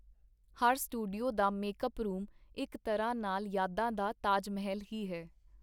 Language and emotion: Punjabi, neutral